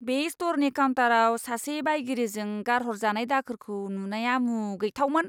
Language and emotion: Bodo, disgusted